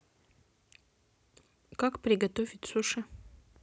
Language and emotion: Russian, neutral